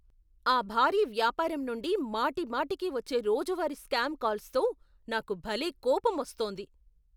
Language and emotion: Telugu, angry